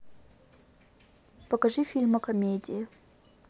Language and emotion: Russian, neutral